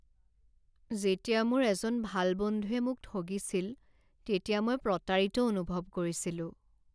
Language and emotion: Assamese, sad